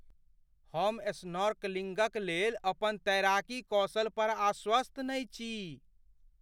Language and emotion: Maithili, fearful